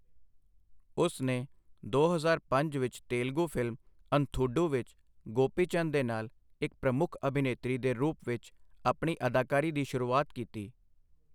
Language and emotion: Punjabi, neutral